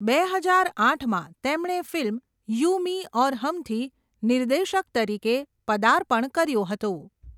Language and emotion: Gujarati, neutral